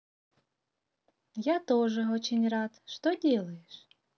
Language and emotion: Russian, positive